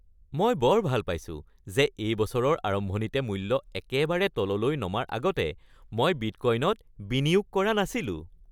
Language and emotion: Assamese, happy